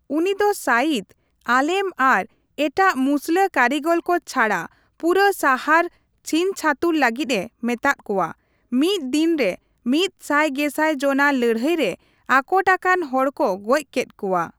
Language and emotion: Santali, neutral